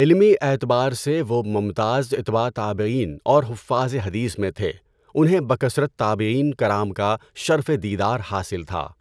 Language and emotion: Urdu, neutral